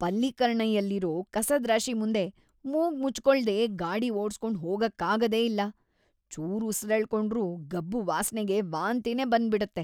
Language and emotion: Kannada, disgusted